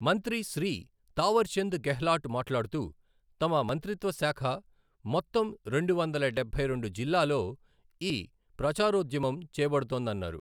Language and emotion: Telugu, neutral